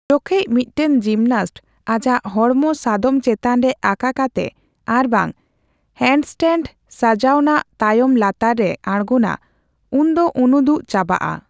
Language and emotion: Santali, neutral